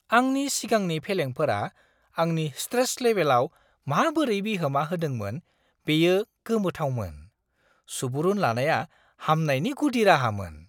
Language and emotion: Bodo, surprised